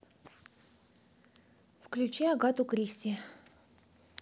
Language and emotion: Russian, neutral